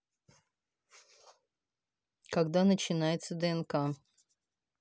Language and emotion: Russian, neutral